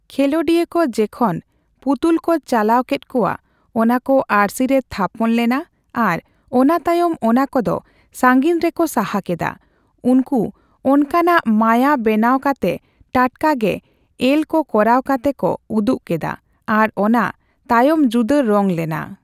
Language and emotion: Santali, neutral